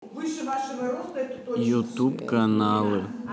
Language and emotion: Russian, neutral